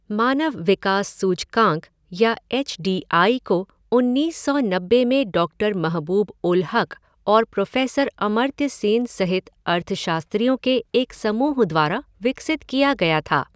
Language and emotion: Hindi, neutral